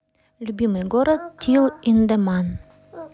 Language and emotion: Russian, neutral